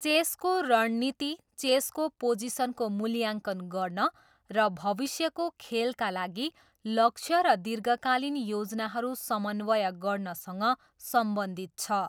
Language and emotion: Nepali, neutral